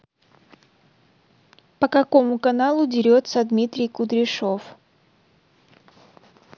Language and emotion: Russian, neutral